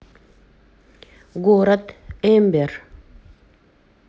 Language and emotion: Russian, neutral